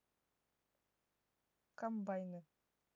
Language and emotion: Russian, neutral